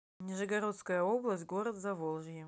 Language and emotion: Russian, neutral